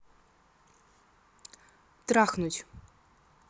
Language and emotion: Russian, neutral